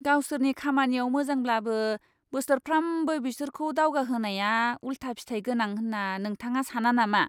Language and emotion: Bodo, disgusted